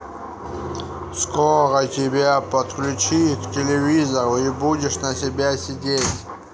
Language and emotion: Russian, neutral